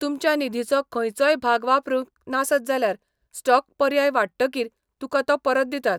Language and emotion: Goan Konkani, neutral